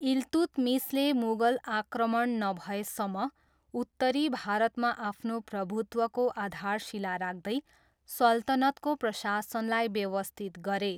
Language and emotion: Nepali, neutral